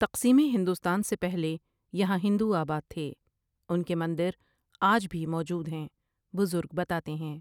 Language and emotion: Urdu, neutral